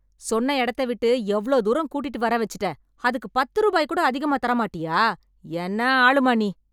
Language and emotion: Tamil, angry